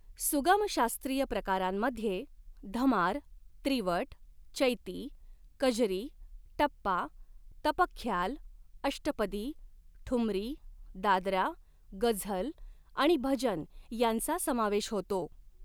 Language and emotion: Marathi, neutral